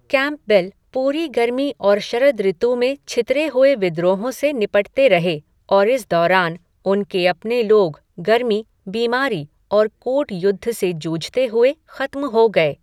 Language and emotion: Hindi, neutral